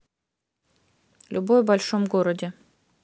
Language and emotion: Russian, neutral